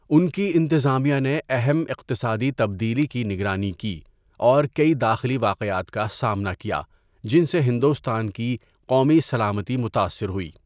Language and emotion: Urdu, neutral